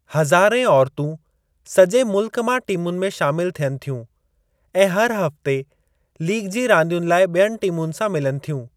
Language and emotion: Sindhi, neutral